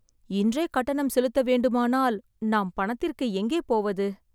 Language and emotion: Tamil, sad